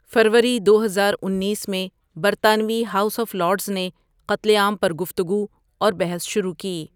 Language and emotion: Urdu, neutral